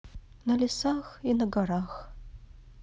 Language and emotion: Russian, sad